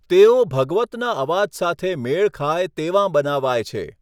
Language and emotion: Gujarati, neutral